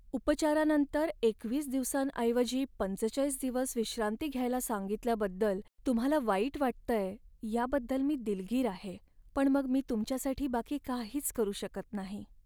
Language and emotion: Marathi, sad